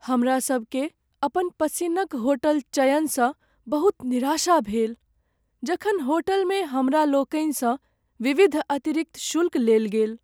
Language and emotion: Maithili, sad